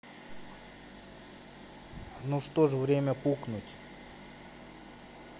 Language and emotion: Russian, neutral